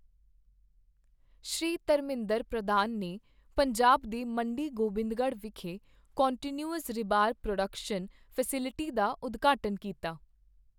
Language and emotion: Punjabi, neutral